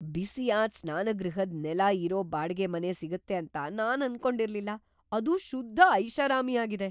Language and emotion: Kannada, surprised